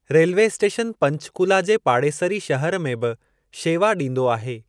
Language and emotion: Sindhi, neutral